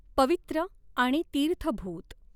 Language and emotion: Marathi, neutral